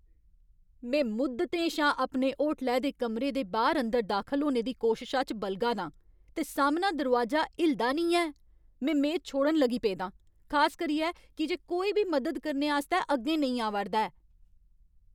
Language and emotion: Dogri, angry